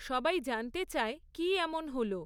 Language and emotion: Bengali, neutral